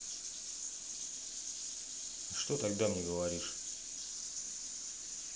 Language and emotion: Russian, neutral